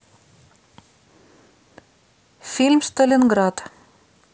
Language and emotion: Russian, neutral